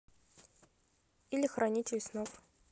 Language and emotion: Russian, neutral